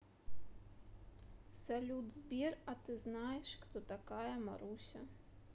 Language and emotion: Russian, neutral